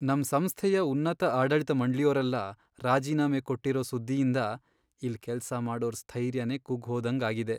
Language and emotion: Kannada, sad